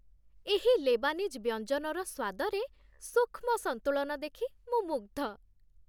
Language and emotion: Odia, happy